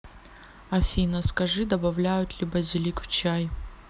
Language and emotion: Russian, neutral